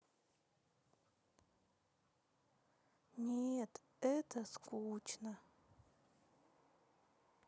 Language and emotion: Russian, sad